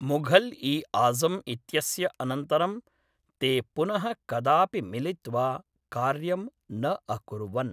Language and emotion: Sanskrit, neutral